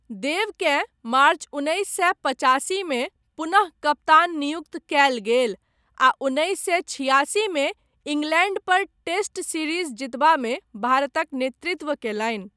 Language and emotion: Maithili, neutral